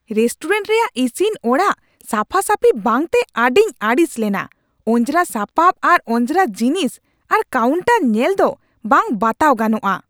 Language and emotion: Santali, angry